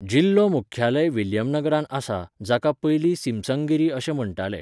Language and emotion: Goan Konkani, neutral